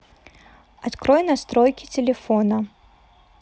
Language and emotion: Russian, neutral